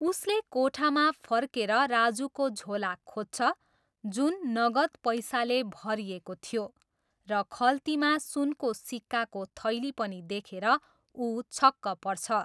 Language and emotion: Nepali, neutral